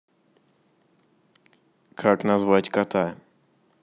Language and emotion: Russian, neutral